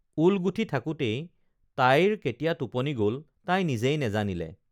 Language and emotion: Assamese, neutral